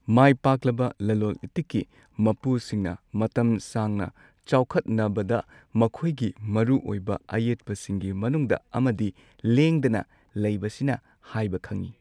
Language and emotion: Manipuri, neutral